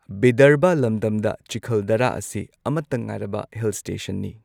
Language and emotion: Manipuri, neutral